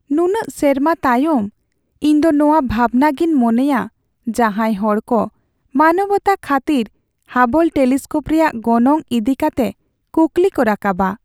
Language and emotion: Santali, sad